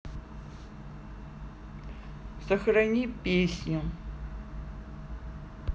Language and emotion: Russian, neutral